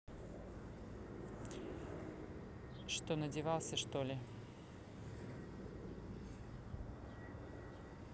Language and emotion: Russian, neutral